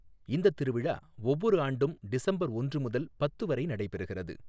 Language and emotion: Tamil, neutral